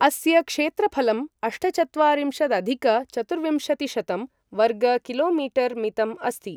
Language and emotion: Sanskrit, neutral